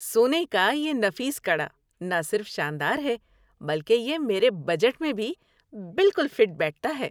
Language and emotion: Urdu, happy